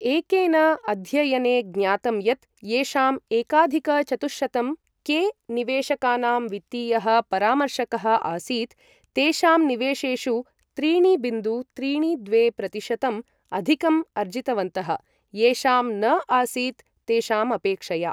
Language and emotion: Sanskrit, neutral